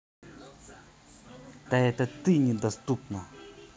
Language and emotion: Russian, angry